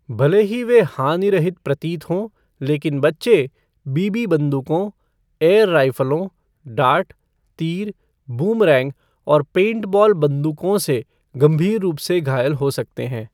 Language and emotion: Hindi, neutral